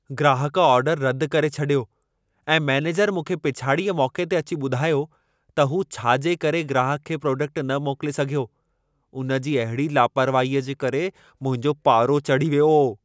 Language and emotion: Sindhi, angry